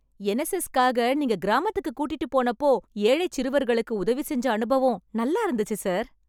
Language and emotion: Tamil, happy